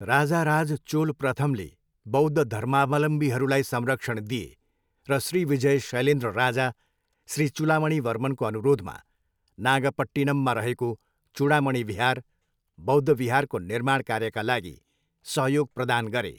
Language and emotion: Nepali, neutral